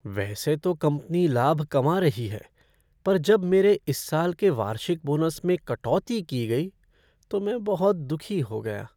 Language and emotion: Hindi, sad